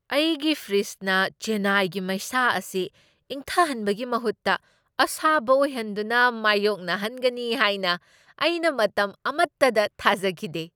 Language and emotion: Manipuri, surprised